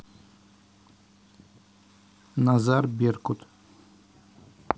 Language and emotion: Russian, neutral